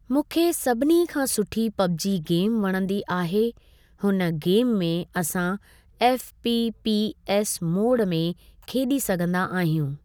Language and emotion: Sindhi, neutral